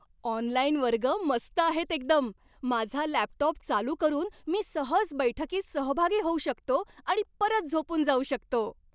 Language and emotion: Marathi, happy